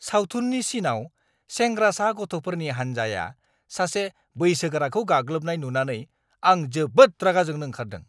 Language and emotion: Bodo, angry